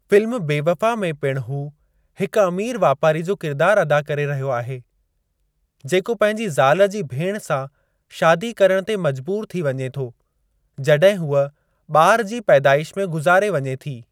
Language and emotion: Sindhi, neutral